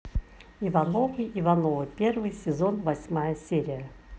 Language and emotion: Russian, neutral